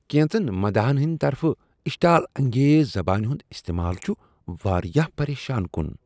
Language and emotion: Kashmiri, disgusted